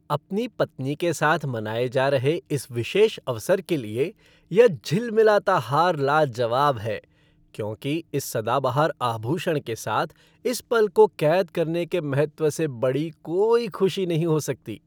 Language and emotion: Hindi, happy